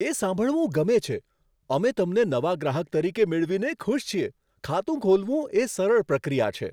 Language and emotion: Gujarati, surprised